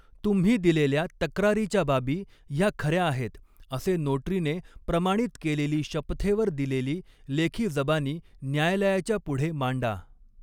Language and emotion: Marathi, neutral